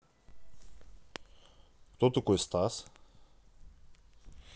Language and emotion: Russian, neutral